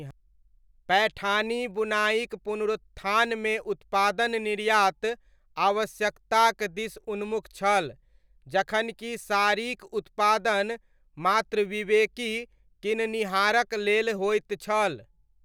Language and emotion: Maithili, neutral